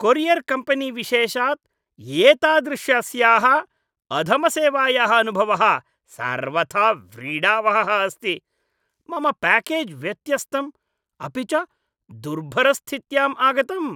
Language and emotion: Sanskrit, disgusted